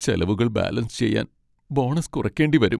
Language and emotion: Malayalam, sad